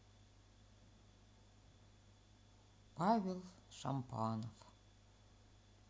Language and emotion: Russian, sad